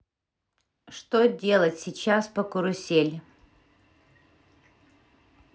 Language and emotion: Russian, neutral